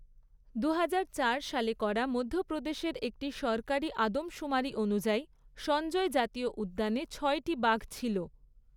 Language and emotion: Bengali, neutral